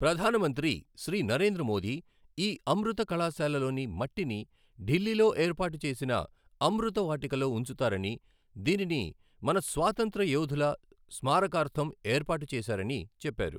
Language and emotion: Telugu, neutral